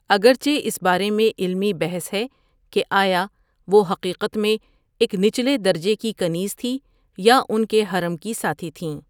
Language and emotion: Urdu, neutral